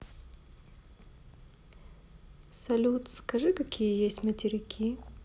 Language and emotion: Russian, neutral